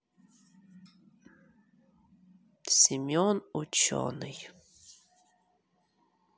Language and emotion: Russian, sad